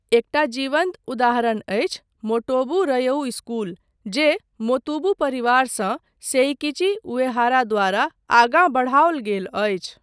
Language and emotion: Maithili, neutral